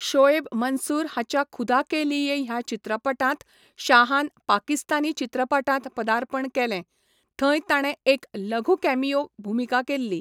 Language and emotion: Goan Konkani, neutral